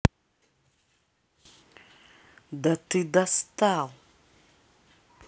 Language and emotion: Russian, angry